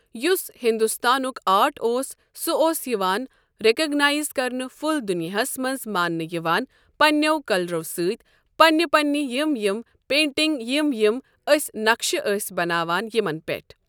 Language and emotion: Kashmiri, neutral